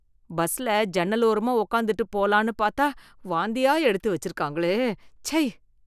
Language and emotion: Tamil, disgusted